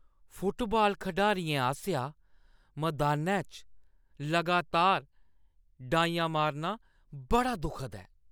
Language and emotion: Dogri, disgusted